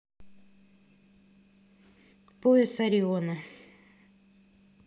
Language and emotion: Russian, neutral